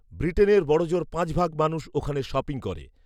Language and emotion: Bengali, neutral